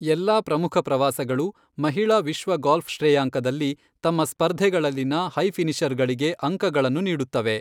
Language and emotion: Kannada, neutral